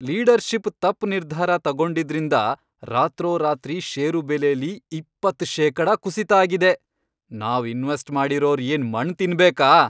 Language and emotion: Kannada, angry